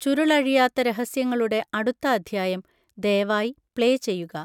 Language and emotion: Malayalam, neutral